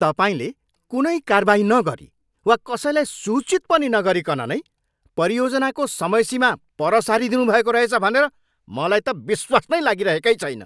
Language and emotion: Nepali, angry